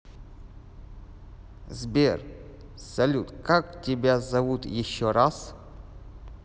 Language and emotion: Russian, neutral